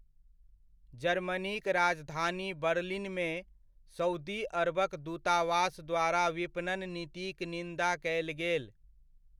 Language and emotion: Maithili, neutral